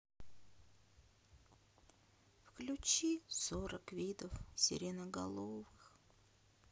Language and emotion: Russian, sad